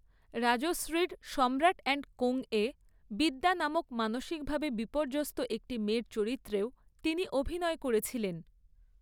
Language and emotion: Bengali, neutral